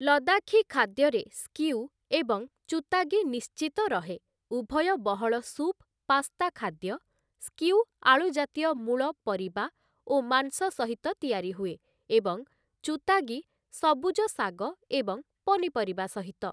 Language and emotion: Odia, neutral